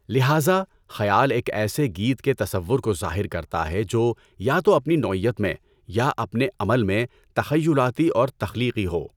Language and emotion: Urdu, neutral